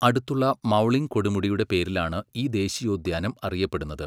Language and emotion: Malayalam, neutral